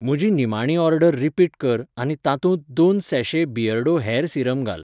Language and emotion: Goan Konkani, neutral